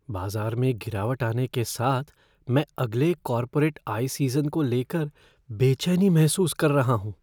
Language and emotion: Hindi, fearful